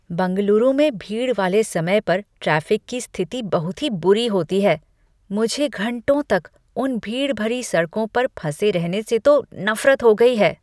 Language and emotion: Hindi, disgusted